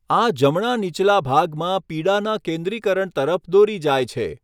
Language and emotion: Gujarati, neutral